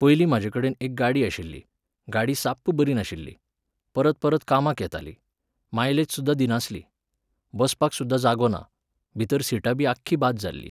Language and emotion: Goan Konkani, neutral